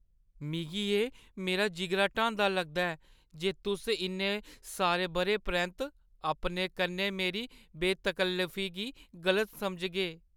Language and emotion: Dogri, sad